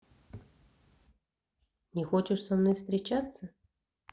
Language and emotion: Russian, neutral